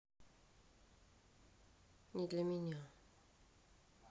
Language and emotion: Russian, sad